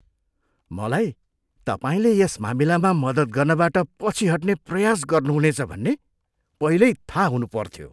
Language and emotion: Nepali, disgusted